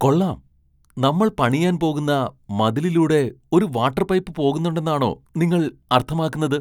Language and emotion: Malayalam, surprised